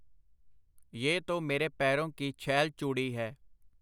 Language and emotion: Punjabi, neutral